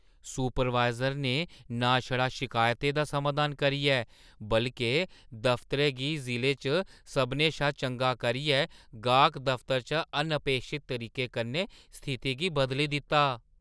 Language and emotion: Dogri, surprised